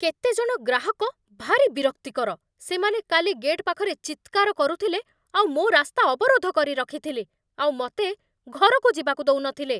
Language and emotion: Odia, angry